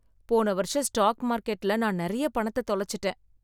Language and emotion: Tamil, sad